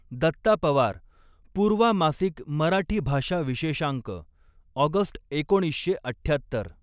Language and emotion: Marathi, neutral